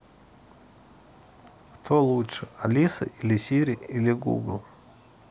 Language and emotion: Russian, neutral